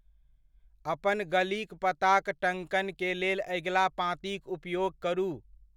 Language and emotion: Maithili, neutral